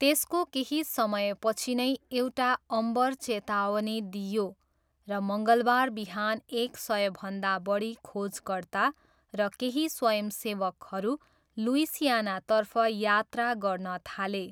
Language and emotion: Nepali, neutral